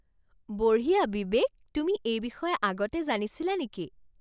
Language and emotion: Assamese, surprised